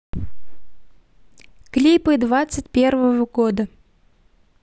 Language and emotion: Russian, neutral